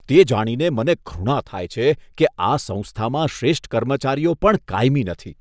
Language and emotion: Gujarati, disgusted